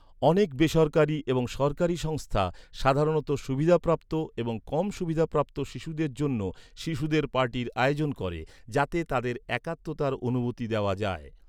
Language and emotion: Bengali, neutral